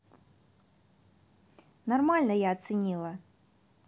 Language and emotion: Russian, angry